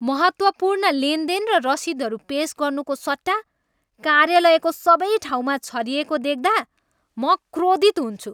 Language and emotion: Nepali, angry